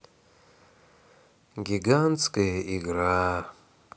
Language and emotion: Russian, sad